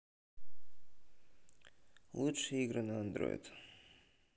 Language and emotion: Russian, neutral